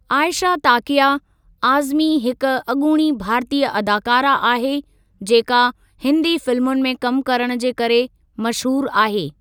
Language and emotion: Sindhi, neutral